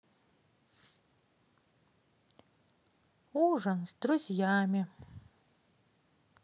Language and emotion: Russian, sad